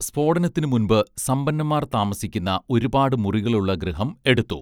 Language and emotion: Malayalam, neutral